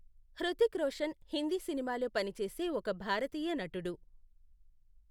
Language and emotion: Telugu, neutral